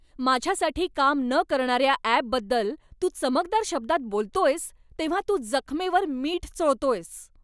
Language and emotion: Marathi, angry